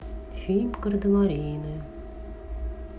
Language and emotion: Russian, neutral